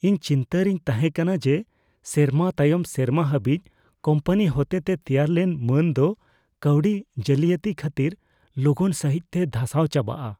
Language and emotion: Santali, fearful